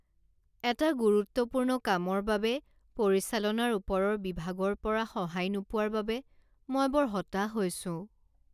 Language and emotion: Assamese, sad